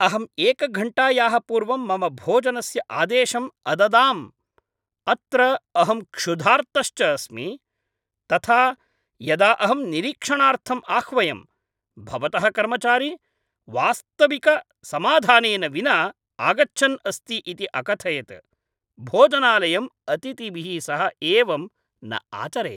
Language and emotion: Sanskrit, angry